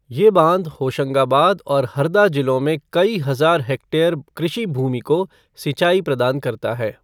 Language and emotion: Hindi, neutral